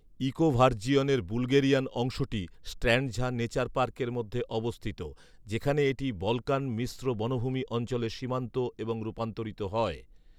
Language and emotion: Bengali, neutral